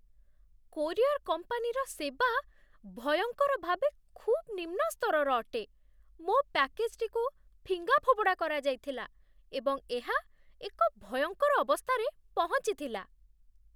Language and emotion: Odia, disgusted